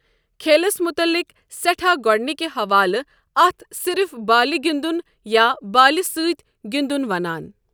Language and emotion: Kashmiri, neutral